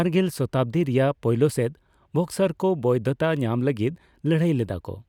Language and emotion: Santali, neutral